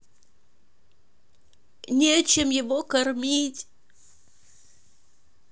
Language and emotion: Russian, sad